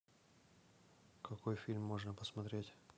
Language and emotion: Russian, neutral